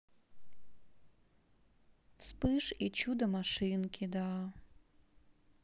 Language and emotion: Russian, sad